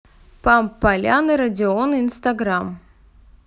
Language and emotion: Russian, neutral